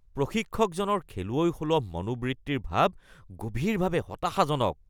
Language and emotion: Assamese, disgusted